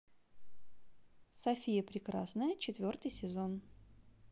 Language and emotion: Russian, neutral